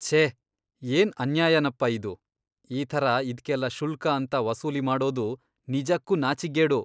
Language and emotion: Kannada, disgusted